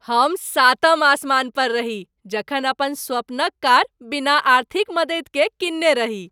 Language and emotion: Maithili, happy